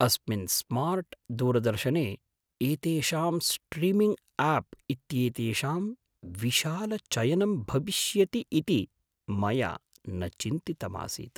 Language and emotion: Sanskrit, surprised